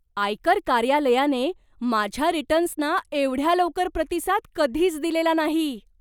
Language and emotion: Marathi, surprised